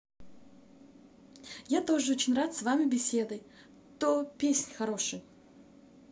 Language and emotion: Russian, positive